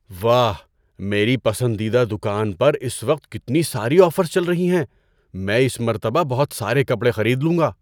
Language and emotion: Urdu, surprised